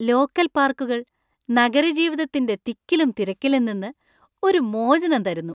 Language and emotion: Malayalam, happy